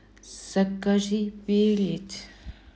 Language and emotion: Russian, neutral